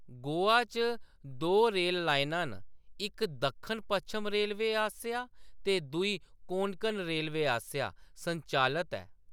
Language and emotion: Dogri, neutral